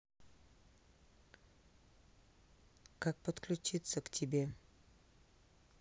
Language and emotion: Russian, neutral